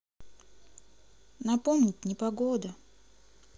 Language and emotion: Russian, sad